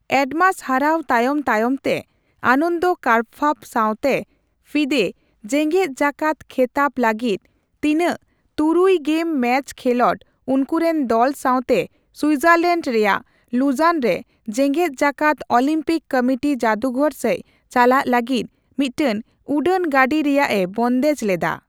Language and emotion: Santali, neutral